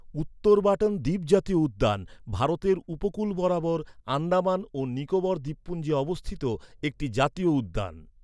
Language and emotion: Bengali, neutral